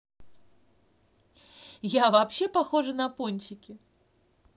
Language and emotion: Russian, positive